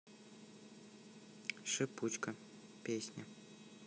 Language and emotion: Russian, neutral